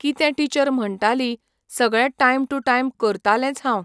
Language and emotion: Goan Konkani, neutral